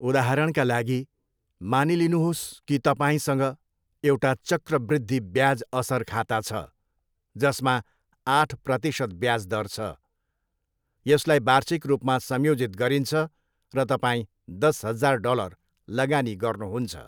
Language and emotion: Nepali, neutral